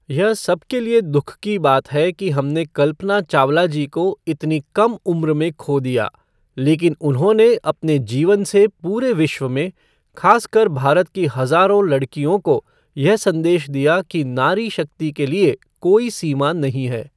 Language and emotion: Hindi, neutral